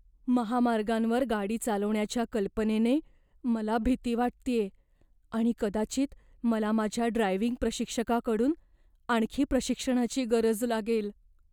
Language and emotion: Marathi, fearful